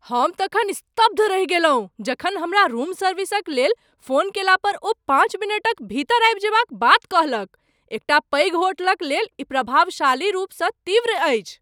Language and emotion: Maithili, surprised